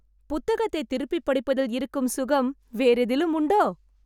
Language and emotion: Tamil, happy